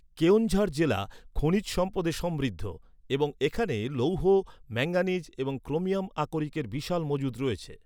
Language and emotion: Bengali, neutral